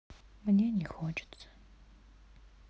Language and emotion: Russian, sad